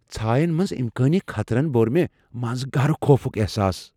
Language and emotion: Kashmiri, fearful